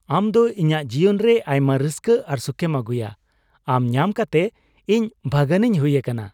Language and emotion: Santali, happy